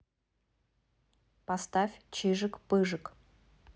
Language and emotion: Russian, neutral